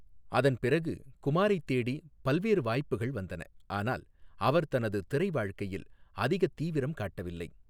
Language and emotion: Tamil, neutral